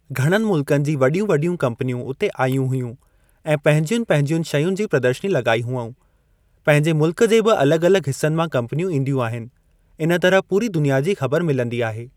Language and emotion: Sindhi, neutral